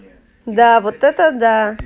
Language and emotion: Russian, positive